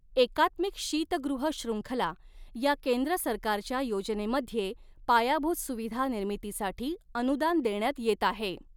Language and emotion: Marathi, neutral